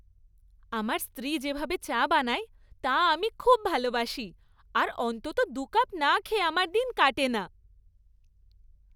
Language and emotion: Bengali, happy